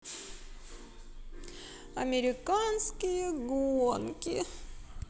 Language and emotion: Russian, sad